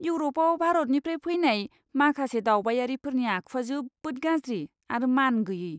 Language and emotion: Bodo, disgusted